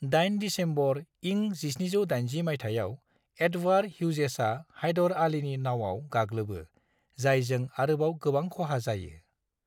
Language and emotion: Bodo, neutral